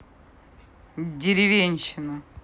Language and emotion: Russian, angry